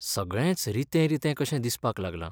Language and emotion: Goan Konkani, sad